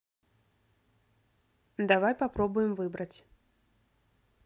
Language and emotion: Russian, neutral